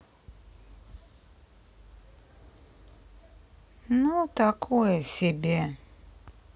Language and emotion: Russian, sad